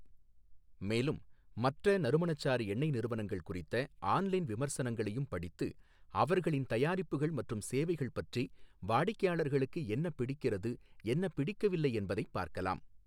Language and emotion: Tamil, neutral